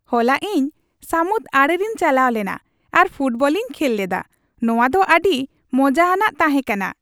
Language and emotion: Santali, happy